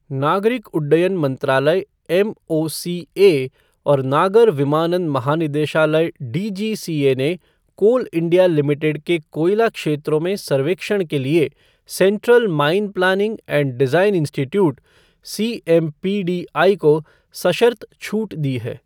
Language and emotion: Hindi, neutral